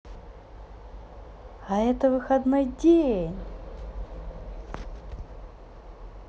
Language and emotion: Russian, positive